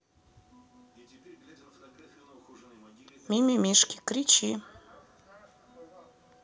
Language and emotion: Russian, neutral